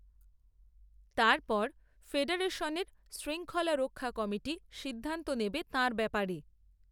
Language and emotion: Bengali, neutral